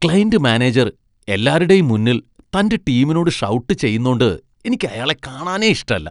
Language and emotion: Malayalam, disgusted